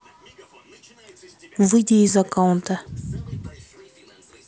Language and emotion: Russian, neutral